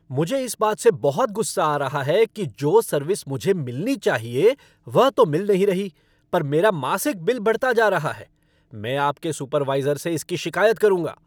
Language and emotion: Hindi, angry